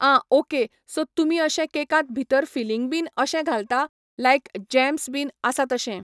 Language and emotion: Goan Konkani, neutral